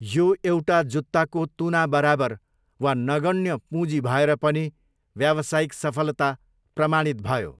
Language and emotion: Nepali, neutral